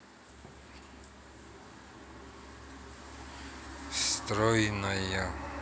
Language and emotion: Russian, neutral